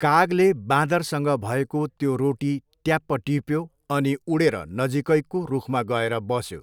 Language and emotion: Nepali, neutral